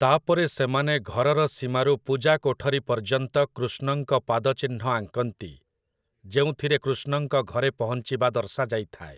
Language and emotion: Odia, neutral